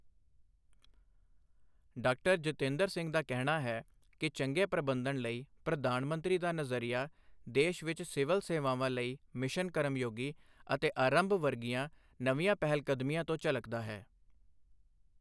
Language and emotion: Punjabi, neutral